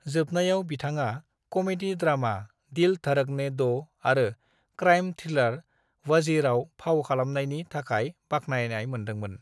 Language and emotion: Bodo, neutral